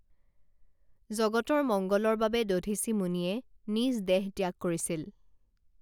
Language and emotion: Assamese, neutral